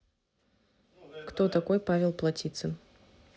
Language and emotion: Russian, neutral